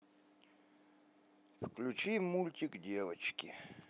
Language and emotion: Russian, neutral